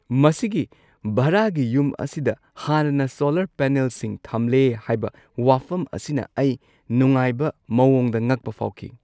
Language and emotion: Manipuri, surprised